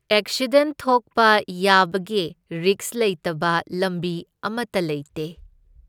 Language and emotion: Manipuri, neutral